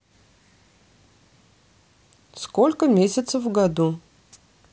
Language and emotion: Russian, neutral